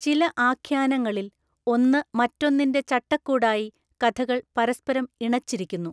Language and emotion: Malayalam, neutral